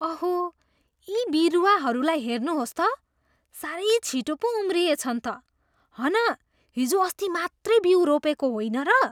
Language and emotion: Nepali, surprised